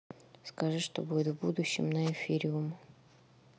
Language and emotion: Russian, neutral